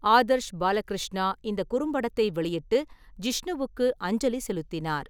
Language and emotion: Tamil, neutral